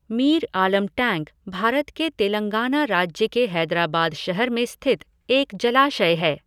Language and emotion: Hindi, neutral